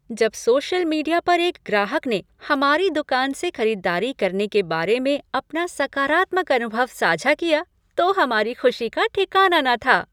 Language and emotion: Hindi, happy